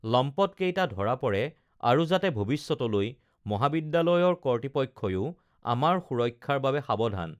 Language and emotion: Assamese, neutral